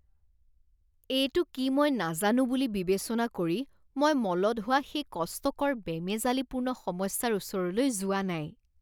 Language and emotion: Assamese, disgusted